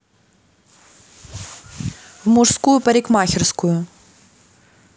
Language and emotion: Russian, neutral